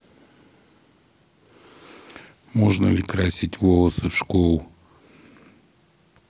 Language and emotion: Russian, neutral